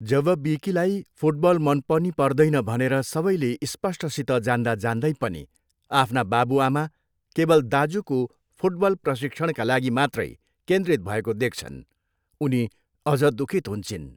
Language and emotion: Nepali, neutral